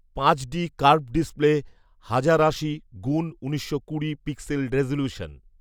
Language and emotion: Bengali, neutral